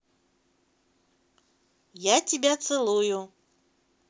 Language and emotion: Russian, positive